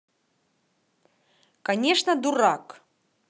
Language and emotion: Russian, neutral